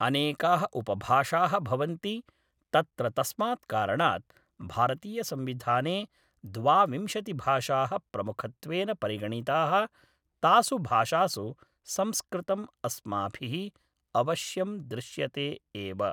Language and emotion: Sanskrit, neutral